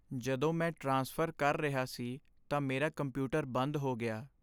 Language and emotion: Punjabi, sad